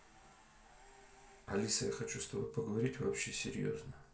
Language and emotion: Russian, neutral